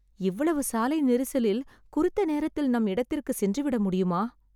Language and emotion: Tamil, sad